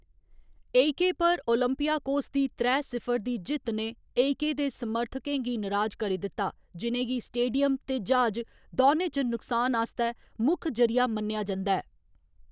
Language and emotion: Dogri, neutral